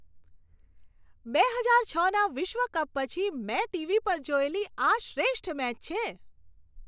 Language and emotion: Gujarati, happy